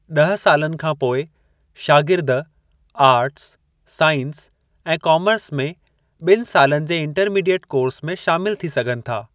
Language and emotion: Sindhi, neutral